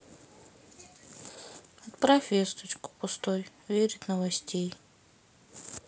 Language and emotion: Russian, sad